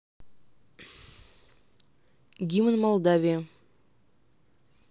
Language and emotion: Russian, neutral